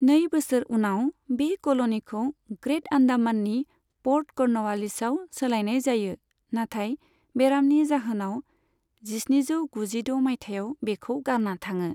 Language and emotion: Bodo, neutral